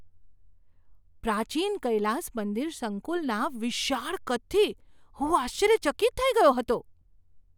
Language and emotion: Gujarati, surprised